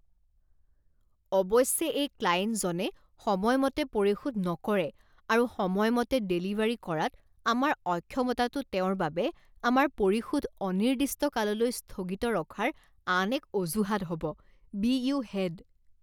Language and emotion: Assamese, disgusted